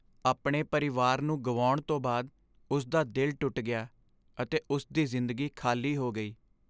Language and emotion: Punjabi, sad